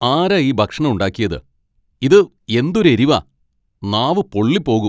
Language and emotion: Malayalam, angry